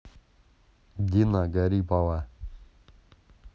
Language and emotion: Russian, neutral